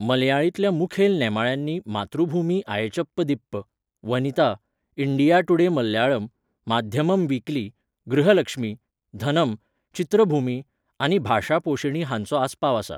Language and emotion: Goan Konkani, neutral